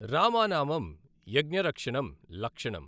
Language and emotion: Telugu, neutral